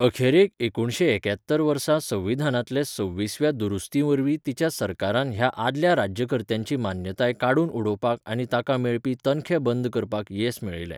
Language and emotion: Goan Konkani, neutral